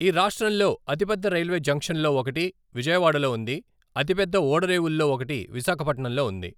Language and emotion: Telugu, neutral